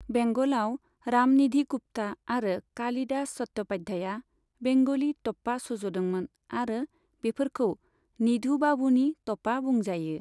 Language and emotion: Bodo, neutral